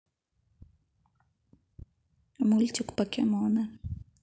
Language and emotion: Russian, neutral